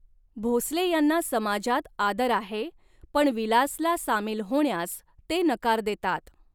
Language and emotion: Marathi, neutral